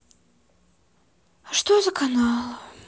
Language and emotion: Russian, sad